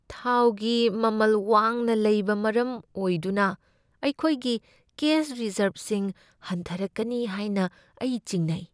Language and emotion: Manipuri, fearful